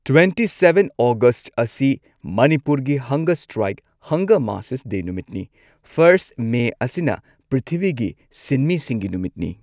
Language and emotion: Manipuri, neutral